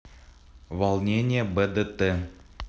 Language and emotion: Russian, neutral